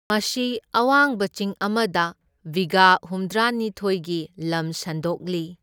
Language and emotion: Manipuri, neutral